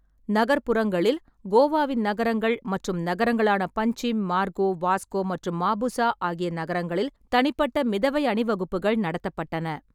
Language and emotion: Tamil, neutral